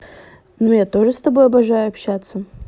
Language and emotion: Russian, neutral